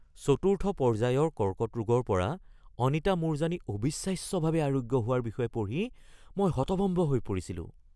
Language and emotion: Assamese, surprised